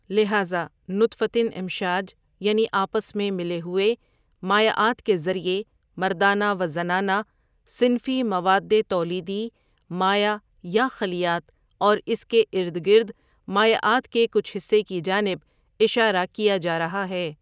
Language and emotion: Urdu, neutral